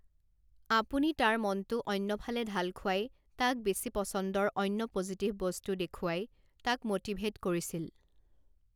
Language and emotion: Assamese, neutral